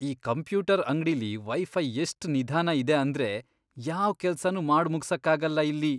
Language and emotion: Kannada, disgusted